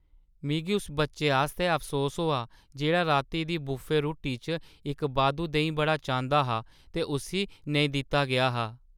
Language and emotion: Dogri, sad